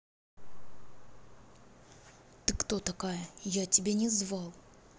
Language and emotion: Russian, angry